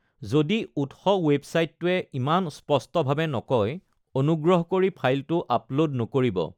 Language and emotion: Assamese, neutral